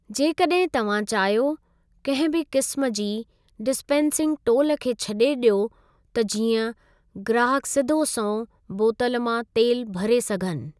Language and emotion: Sindhi, neutral